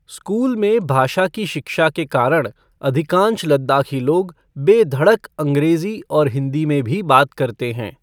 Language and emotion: Hindi, neutral